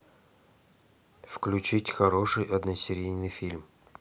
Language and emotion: Russian, neutral